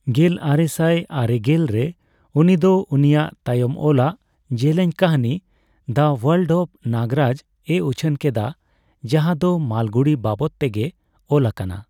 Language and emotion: Santali, neutral